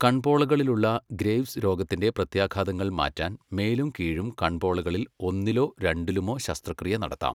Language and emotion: Malayalam, neutral